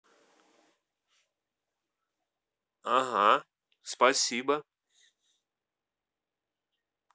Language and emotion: Russian, positive